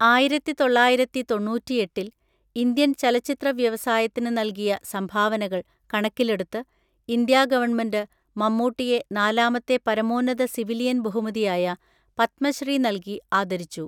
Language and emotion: Malayalam, neutral